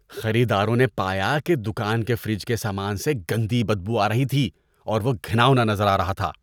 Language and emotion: Urdu, disgusted